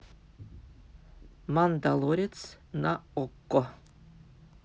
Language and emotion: Russian, neutral